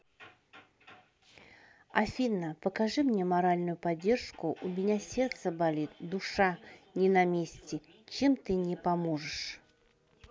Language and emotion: Russian, neutral